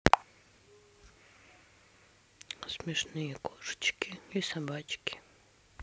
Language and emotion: Russian, sad